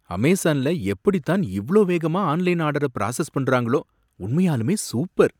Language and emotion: Tamil, surprised